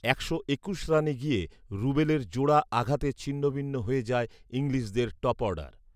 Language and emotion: Bengali, neutral